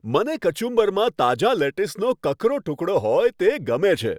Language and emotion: Gujarati, happy